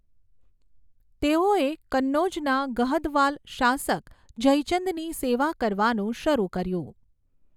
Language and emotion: Gujarati, neutral